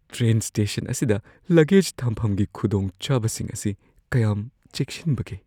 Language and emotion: Manipuri, fearful